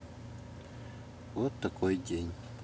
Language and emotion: Russian, sad